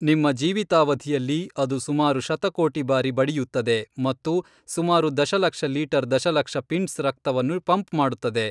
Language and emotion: Kannada, neutral